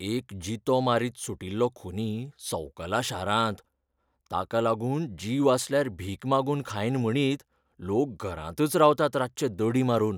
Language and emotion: Goan Konkani, fearful